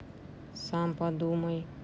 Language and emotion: Russian, neutral